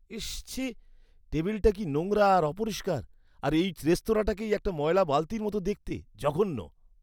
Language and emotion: Bengali, disgusted